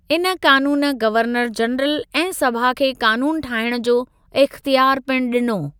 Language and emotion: Sindhi, neutral